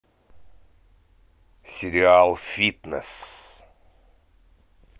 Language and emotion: Russian, positive